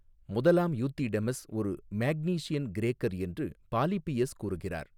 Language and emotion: Tamil, neutral